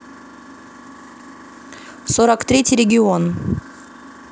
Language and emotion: Russian, neutral